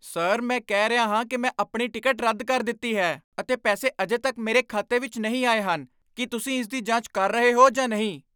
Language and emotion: Punjabi, angry